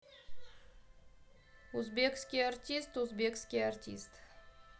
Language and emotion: Russian, neutral